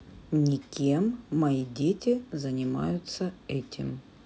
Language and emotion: Russian, neutral